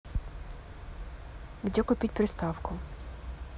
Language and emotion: Russian, neutral